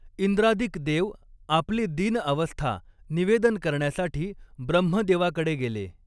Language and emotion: Marathi, neutral